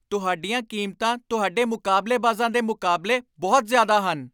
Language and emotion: Punjabi, angry